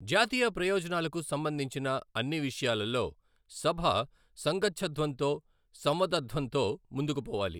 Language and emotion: Telugu, neutral